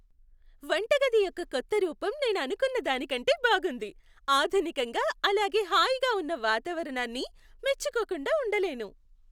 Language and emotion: Telugu, happy